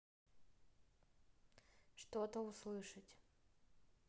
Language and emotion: Russian, neutral